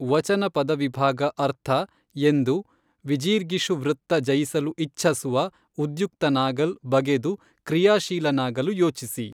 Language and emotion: Kannada, neutral